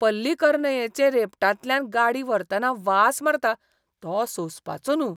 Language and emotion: Goan Konkani, disgusted